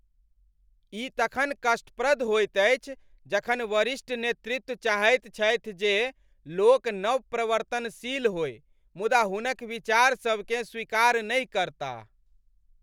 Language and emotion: Maithili, angry